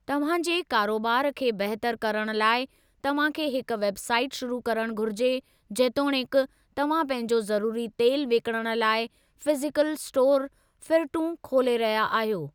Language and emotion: Sindhi, neutral